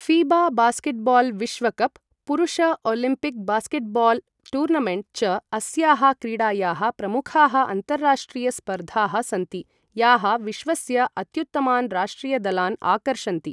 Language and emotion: Sanskrit, neutral